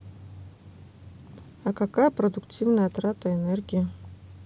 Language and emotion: Russian, neutral